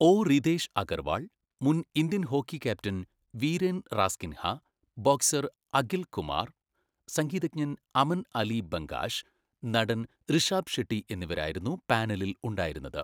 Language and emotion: Malayalam, neutral